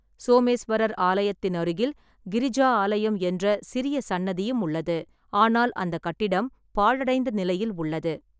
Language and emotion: Tamil, neutral